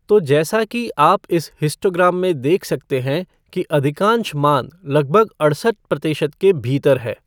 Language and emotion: Hindi, neutral